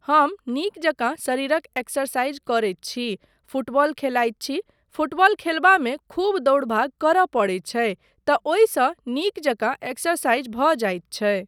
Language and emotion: Maithili, neutral